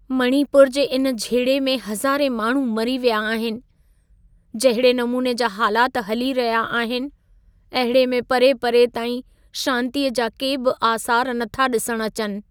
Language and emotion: Sindhi, sad